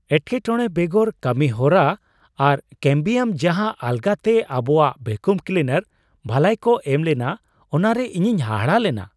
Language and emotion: Santali, surprised